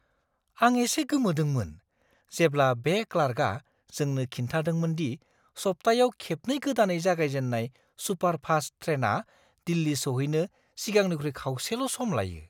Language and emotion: Bodo, surprised